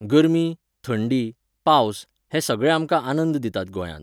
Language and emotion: Goan Konkani, neutral